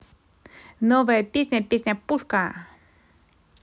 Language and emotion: Russian, positive